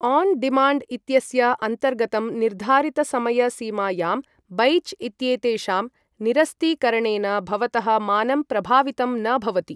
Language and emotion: Sanskrit, neutral